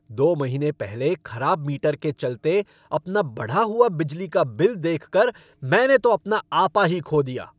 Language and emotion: Hindi, angry